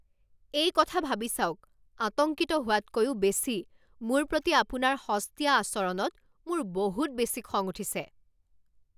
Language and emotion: Assamese, angry